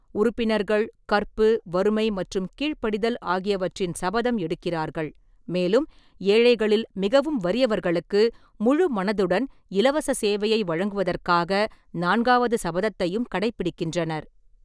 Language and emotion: Tamil, neutral